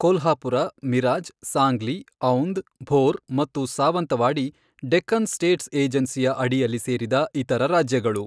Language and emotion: Kannada, neutral